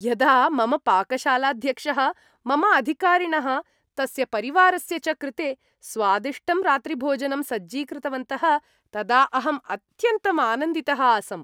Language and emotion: Sanskrit, happy